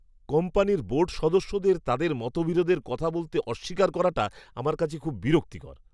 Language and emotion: Bengali, disgusted